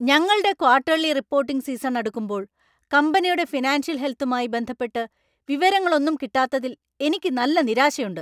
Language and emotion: Malayalam, angry